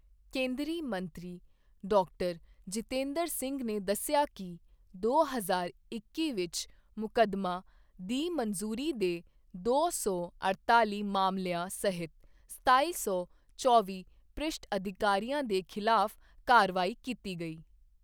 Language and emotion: Punjabi, neutral